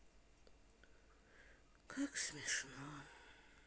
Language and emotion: Russian, sad